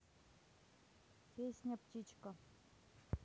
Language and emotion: Russian, neutral